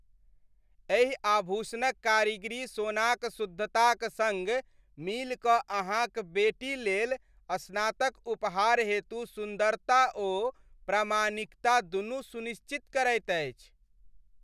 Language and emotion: Maithili, happy